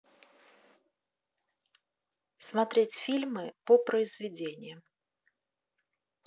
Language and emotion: Russian, neutral